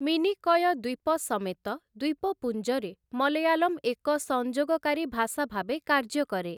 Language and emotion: Odia, neutral